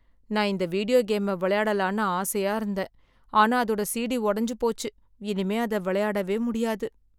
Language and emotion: Tamil, sad